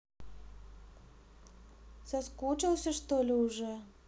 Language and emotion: Russian, neutral